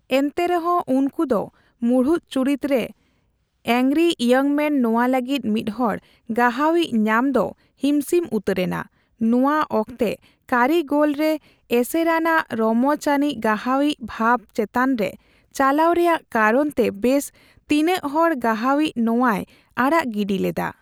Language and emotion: Santali, neutral